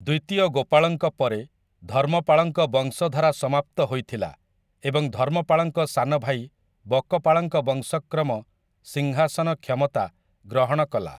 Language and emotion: Odia, neutral